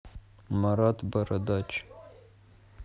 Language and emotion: Russian, neutral